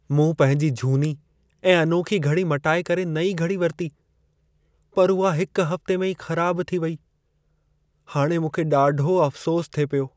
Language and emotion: Sindhi, sad